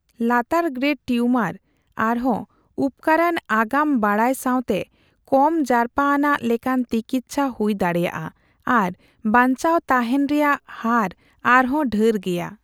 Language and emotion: Santali, neutral